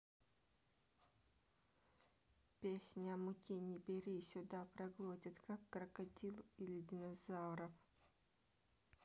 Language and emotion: Russian, neutral